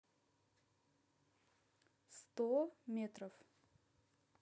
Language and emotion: Russian, neutral